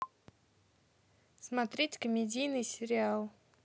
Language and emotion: Russian, neutral